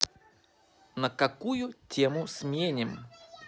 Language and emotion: Russian, positive